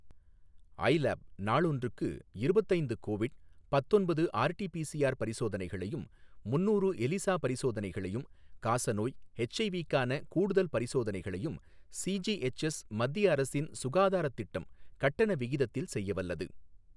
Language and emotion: Tamil, neutral